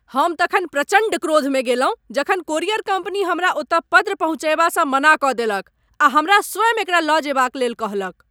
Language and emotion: Maithili, angry